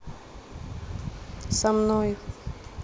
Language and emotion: Russian, neutral